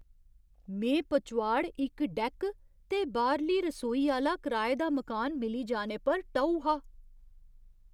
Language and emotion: Dogri, surprised